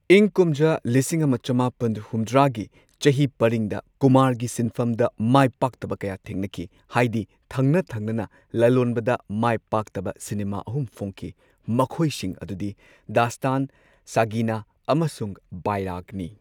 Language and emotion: Manipuri, neutral